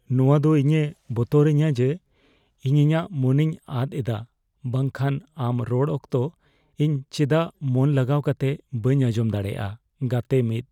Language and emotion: Santali, fearful